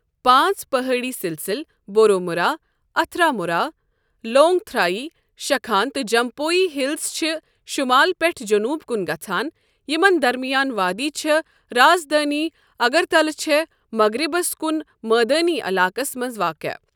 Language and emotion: Kashmiri, neutral